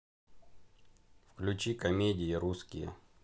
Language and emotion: Russian, neutral